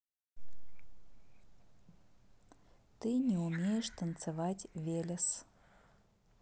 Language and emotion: Russian, neutral